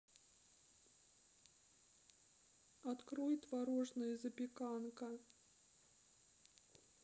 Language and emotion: Russian, sad